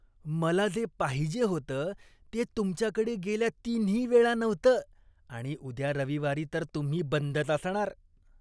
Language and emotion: Marathi, disgusted